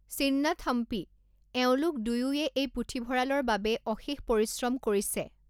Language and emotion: Assamese, neutral